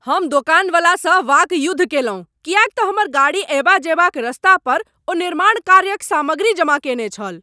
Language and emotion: Maithili, angry